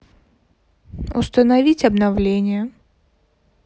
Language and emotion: Russian, neutral